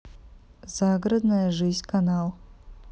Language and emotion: Russian, neutral